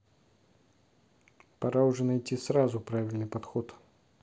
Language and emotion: Russian, angry